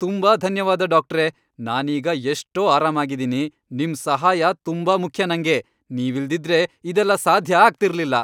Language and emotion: Kannada, happy